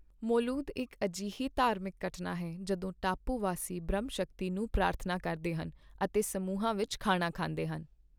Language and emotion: Punjabi, neutral